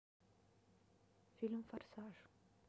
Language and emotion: Russian, neutral